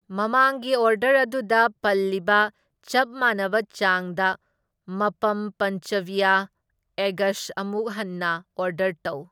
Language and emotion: Manipuri, neutral